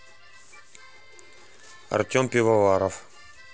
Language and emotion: Russian, neutral